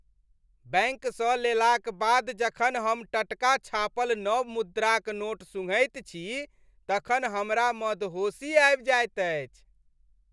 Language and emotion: Maithili, happy